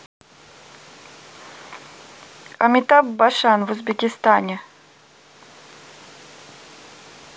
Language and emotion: Russian, neutral